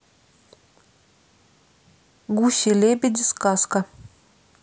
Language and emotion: Russian, neutral